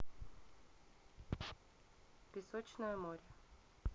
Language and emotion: Russian, neutral